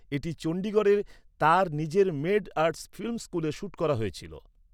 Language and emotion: Bengali, neutral